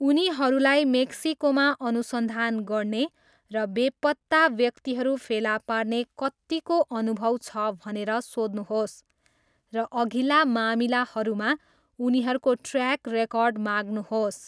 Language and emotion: Nepali, neutral